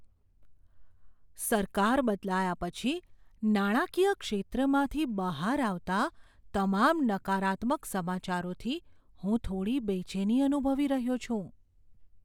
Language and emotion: Gujarati, fearful